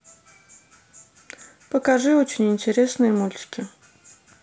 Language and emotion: Russian, neutral